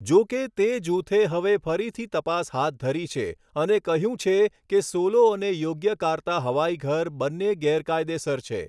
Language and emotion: Gujarati, neutral